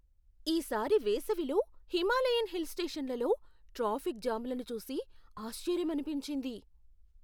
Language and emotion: Telugu, surprised